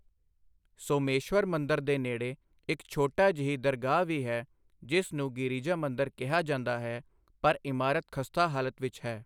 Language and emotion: Punjabi, neutral